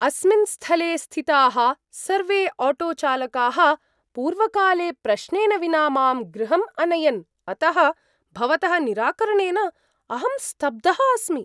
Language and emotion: Sanskrit, surprised